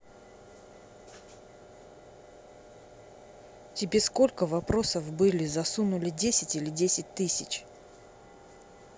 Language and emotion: Russian, angry